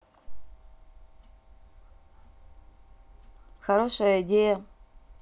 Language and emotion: Russian, neutral